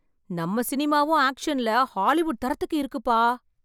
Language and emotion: Tamil, surprised